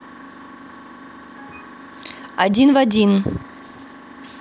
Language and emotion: Russian, neutral